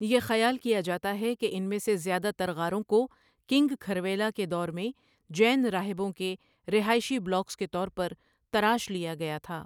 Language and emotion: Urdu, neutral